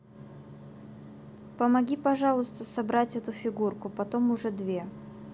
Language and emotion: Russian, neutral